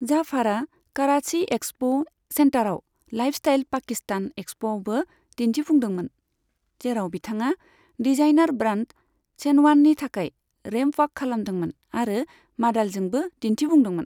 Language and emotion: Bodo, neutral